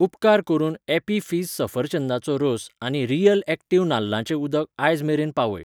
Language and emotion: Goan Konkani, neutral